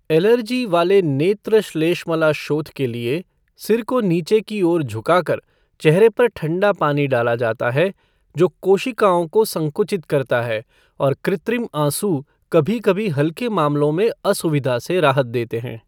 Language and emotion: Hindi, neutral